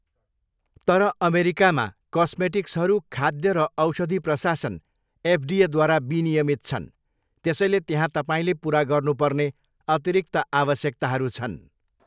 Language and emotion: Nepali, neutral